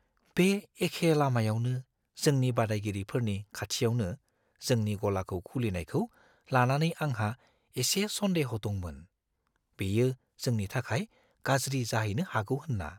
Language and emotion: Bodo, fearful